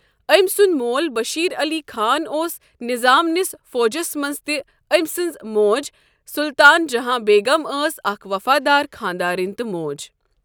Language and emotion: Kashmiri, neutral